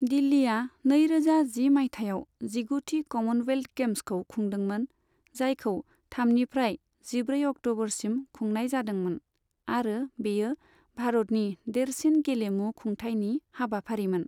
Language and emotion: Bodo, neutral